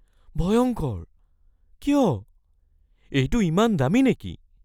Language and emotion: Assamese, fearful